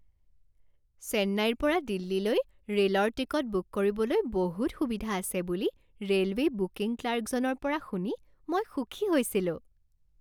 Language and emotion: Assamese, happy